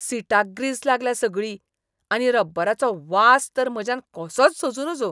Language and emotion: Goan Konkani, disgusted